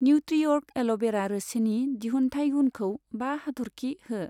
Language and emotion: Bodo, neutral